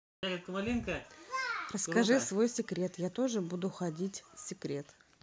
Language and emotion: Russian, positive